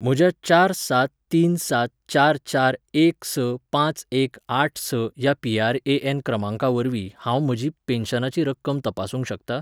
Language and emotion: Goan Konkani, neutral